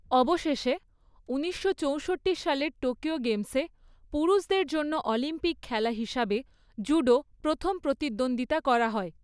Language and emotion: Bengali, neutral